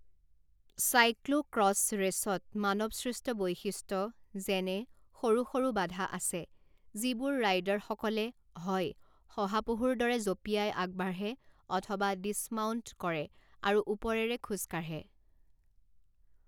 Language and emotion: Assamese, neutral